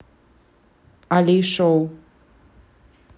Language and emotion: Russian, neutral